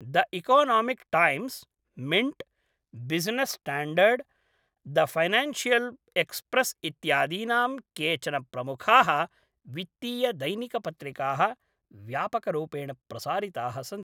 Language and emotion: Sanskrit, neutral